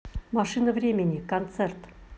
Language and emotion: Russian, neutral